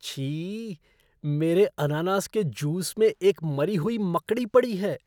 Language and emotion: Hindi, disgusted